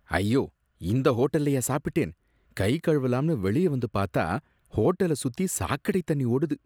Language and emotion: Tamil, disgusted